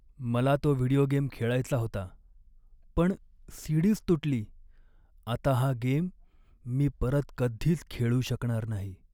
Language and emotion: Marathi, sad